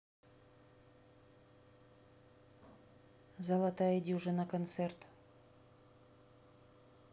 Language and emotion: Russian, neutral